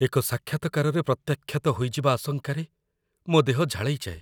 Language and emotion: Odia, fearful